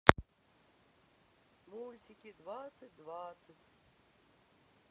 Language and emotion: Russian, sad